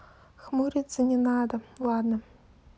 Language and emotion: Russian, neutral